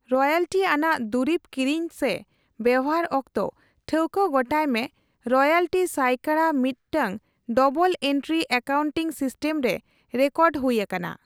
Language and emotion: Santali, neutral